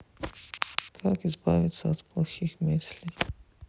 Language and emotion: Russian, sad